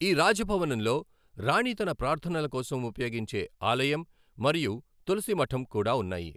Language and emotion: Telugu, neutral